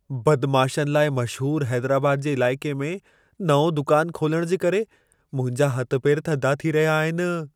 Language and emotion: Sindhi, fearful